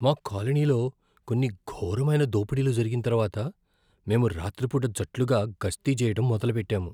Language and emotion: Telugu, fearful